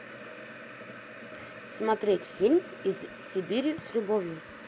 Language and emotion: Russian, neutral